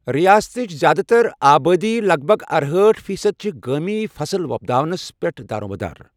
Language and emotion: Kashmiri, neutral